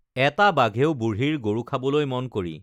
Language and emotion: Assamese, neutral